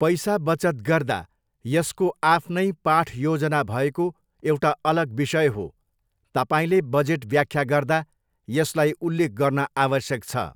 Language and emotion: Nepali, neutral